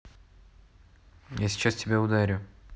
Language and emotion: Russian, neutral